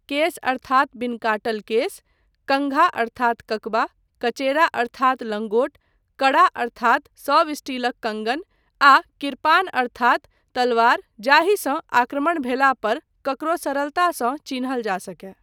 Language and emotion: Maithili, neutral